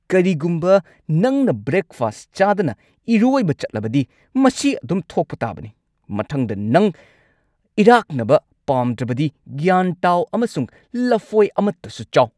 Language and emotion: Manipuri, angry